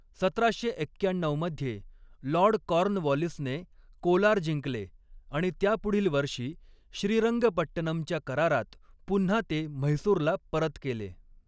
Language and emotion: Marathi, neutral